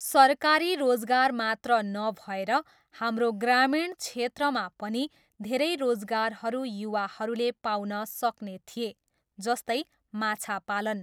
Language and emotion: Nepali, neutral